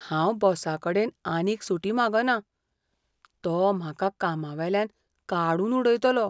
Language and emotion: Goan Konkani, fearful